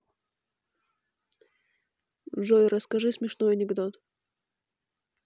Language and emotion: Russian, neutral